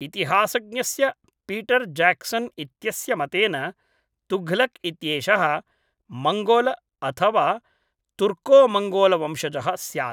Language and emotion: Sanskrit, neutral